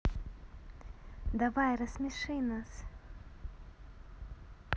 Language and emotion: Russian, neutral